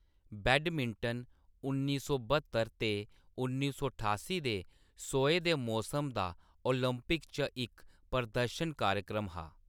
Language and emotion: Dogri, neutral